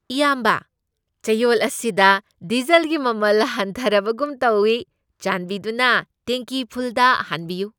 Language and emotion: Manipuri, happy